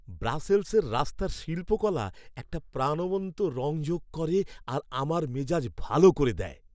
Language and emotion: Bengali, happy